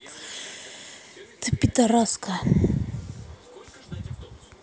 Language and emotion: Russian, angry